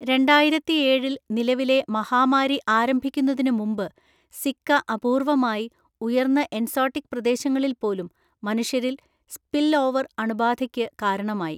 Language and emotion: Malayalam, neutral